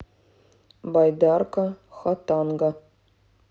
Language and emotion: Russian, neutral